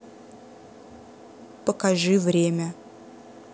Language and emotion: Russian, neutral